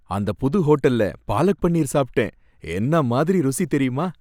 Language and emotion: Tamil, happy